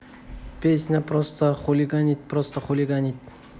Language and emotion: Russian, neutral